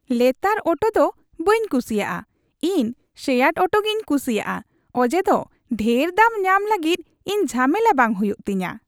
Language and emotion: Santali, happy